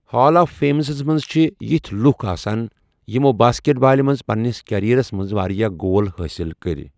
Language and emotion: Kashmiri, neutral